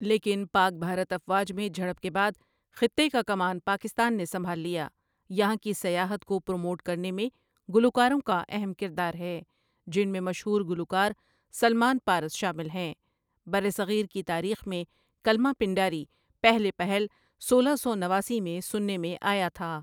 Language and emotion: Urdu, neutral